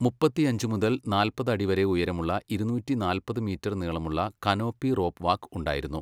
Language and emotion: Malayalam, neutral